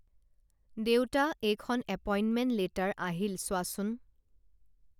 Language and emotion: Assamese, neutral